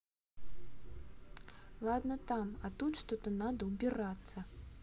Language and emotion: Russian, angry